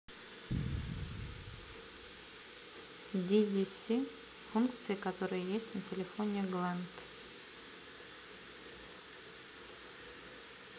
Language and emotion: Russian, neutral